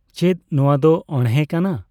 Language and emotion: Santali, neutral